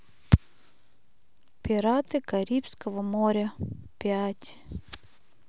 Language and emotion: Russian, neutral